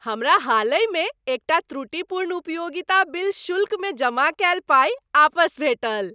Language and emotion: Maithili, happy